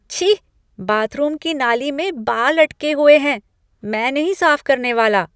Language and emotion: Hindi, disgusted